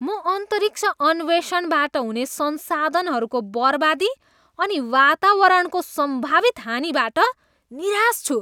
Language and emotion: Nepali, disgusted